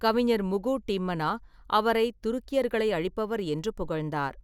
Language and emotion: Tamil, neutral